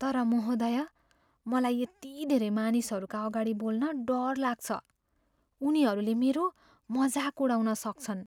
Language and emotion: Nepali, fearful